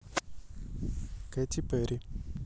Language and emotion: Russian, neutral